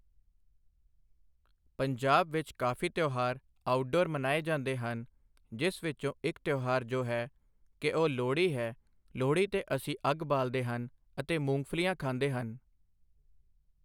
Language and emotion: Punjabi, neutral